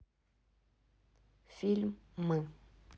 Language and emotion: Russian, neutral